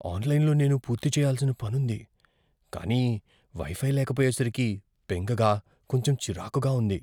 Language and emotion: Telugu, fearful